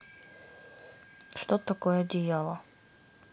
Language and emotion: Russian, neutral